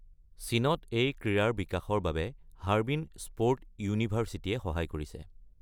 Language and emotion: Assamese, neutral